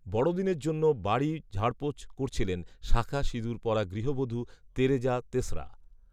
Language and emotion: Bengali, neutral